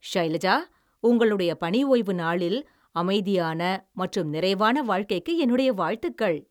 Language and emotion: Tamil, happy